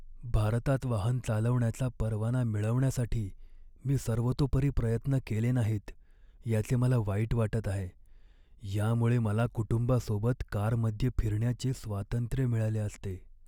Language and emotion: Marathi, sad